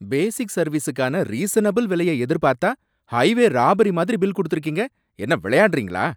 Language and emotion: Tamil, angry